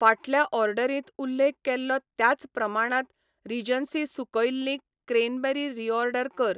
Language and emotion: Goan Konkani, neutral